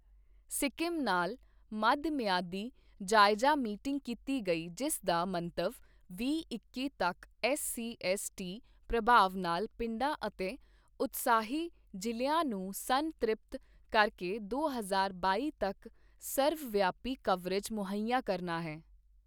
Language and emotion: Punjabi, neutral